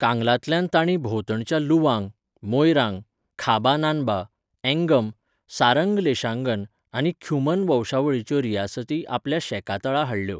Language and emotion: Goan Konkani, neutral